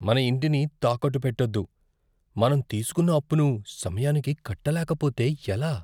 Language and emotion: Telugu, fearful